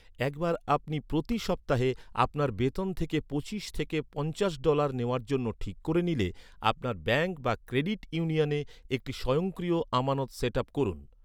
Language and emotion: Bengali, neutral